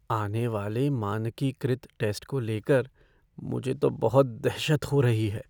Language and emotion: Hindi, fearful